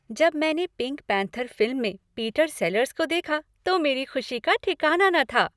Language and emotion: Hindi, happy